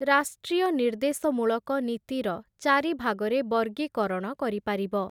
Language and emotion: Odia, neutral